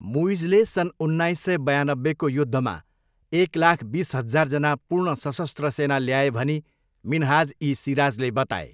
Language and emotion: Nepali, neutral